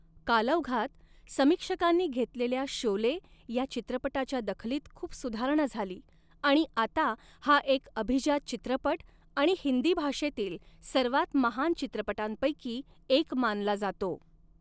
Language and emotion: Marathi, neutral